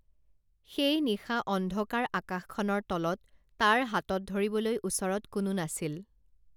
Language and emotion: Assamese, neutral